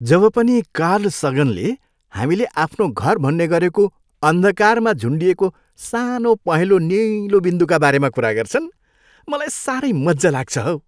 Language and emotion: Nepali, happy